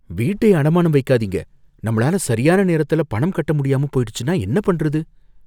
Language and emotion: Tamil, fearful